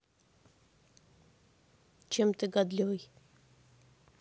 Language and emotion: Russian, neutral